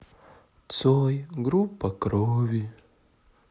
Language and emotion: Russian, sad